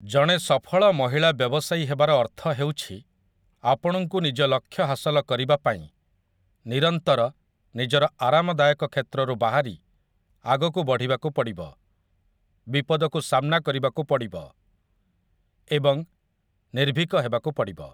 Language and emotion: Odia, neutral